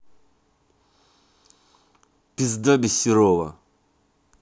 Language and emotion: Russian, angry